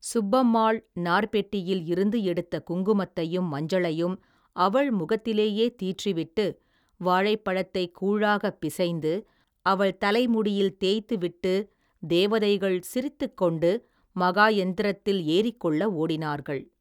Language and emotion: Tamil, neutral